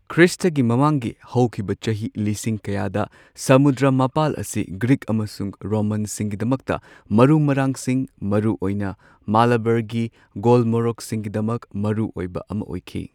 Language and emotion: Manipuri, neutral